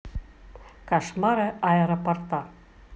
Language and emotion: Russian, neutral